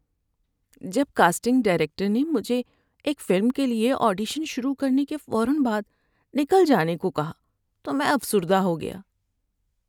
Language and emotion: Urdu, sad